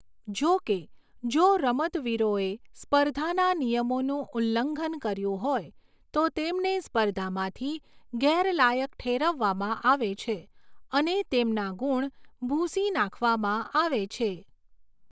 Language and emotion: Gujarati, neutral